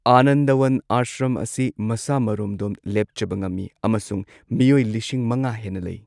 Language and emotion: Manipuri, neutral